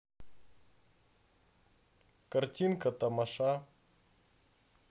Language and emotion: Russian, neutral